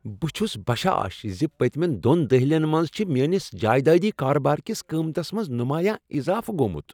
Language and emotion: Kashmiri, happy